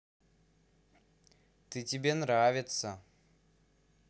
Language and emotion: Russian, positive